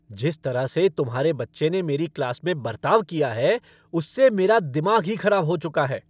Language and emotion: Hindi, angry